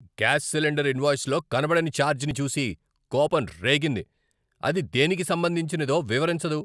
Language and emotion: Telugu, angry